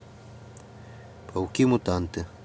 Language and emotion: Russian, neutral